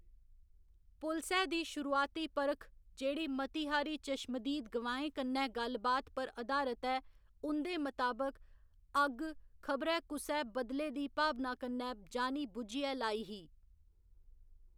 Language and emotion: Dogri, neutral